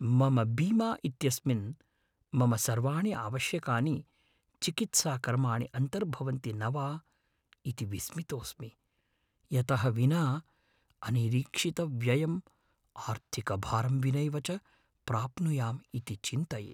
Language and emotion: Sanskrit, fearful